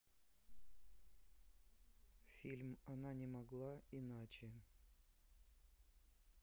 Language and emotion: Russian, neutral